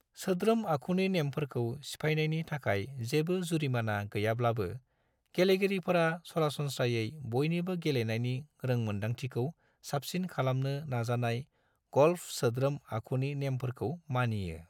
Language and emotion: Bodo, neutral